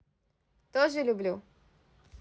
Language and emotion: Russian, positive